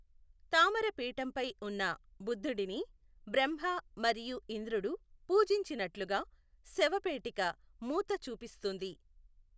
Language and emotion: Telugu, neutral